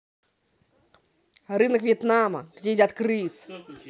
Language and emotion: Russian, angry